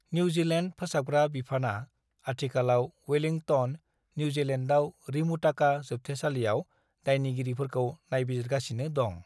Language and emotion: Bodo, neutral